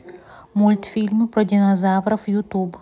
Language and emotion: Russian, neutral